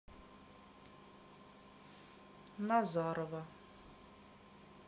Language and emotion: Russian, neutral